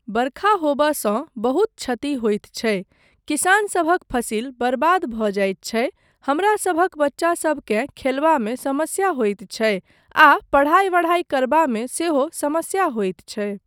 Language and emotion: Maithili, neutral